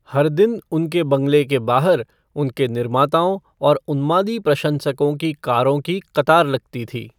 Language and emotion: Hindi, neutral